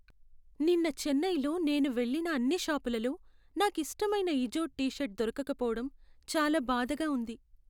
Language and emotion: Telugu, sad